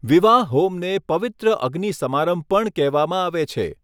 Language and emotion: Gujarati, neutral